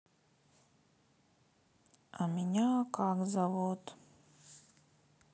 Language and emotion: Russian, neutral